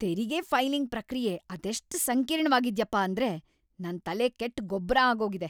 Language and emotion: Kannada, angry